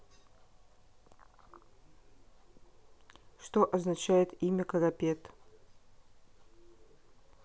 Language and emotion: Russian, neutral